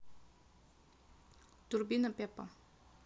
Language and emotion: Russian, neutral